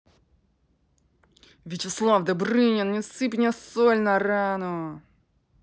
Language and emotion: Russian, angry